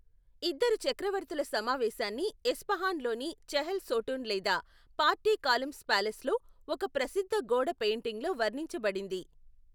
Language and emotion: Telugu, neutral